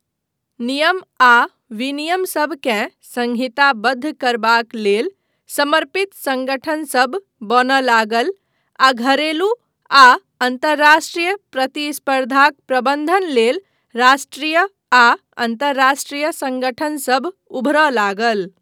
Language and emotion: Maithili, neutral